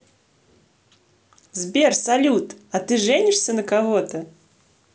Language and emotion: Russian, positive